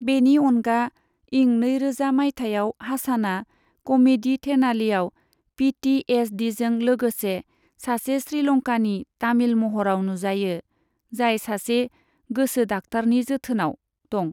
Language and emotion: Bodo, neutral